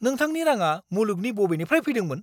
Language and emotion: Bodo, angry